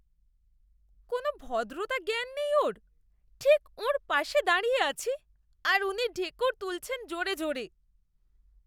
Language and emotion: Bengali, disgusted